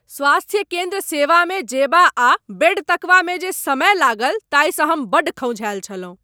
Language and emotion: Maithili, angry